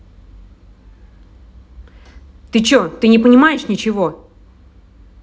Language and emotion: Russian, angry